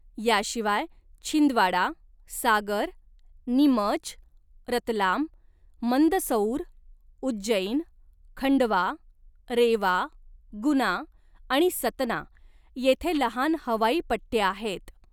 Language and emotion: Marathi, neutral